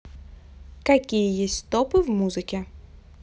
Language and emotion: Russian, neutral